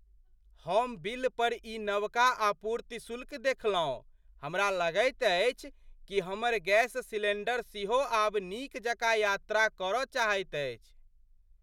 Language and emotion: Maithili, surprised